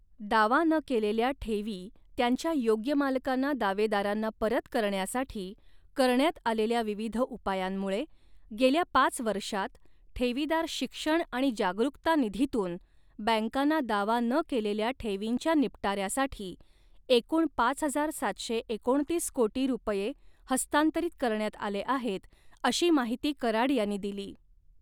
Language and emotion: Marathi, neutral